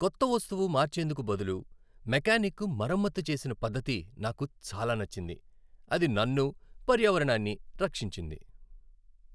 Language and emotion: Telugu, happy